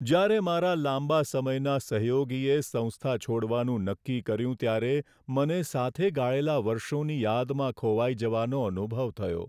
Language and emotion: Gujarati, sad